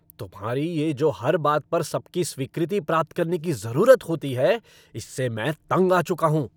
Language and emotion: Hindi, angry